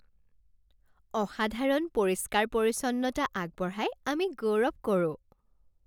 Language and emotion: Assamese, happy